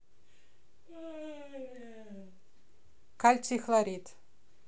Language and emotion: Russian, neutral